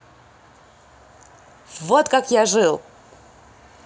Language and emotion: Russian, positive